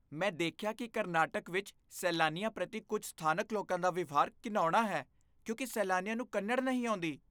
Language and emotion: Punjabi, disgusted